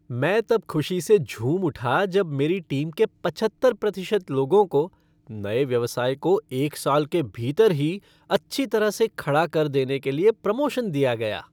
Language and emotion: Hindi, happy